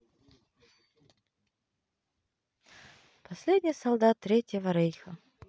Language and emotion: Russian, neutral